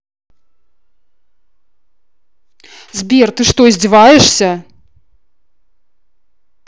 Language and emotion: Russian, angry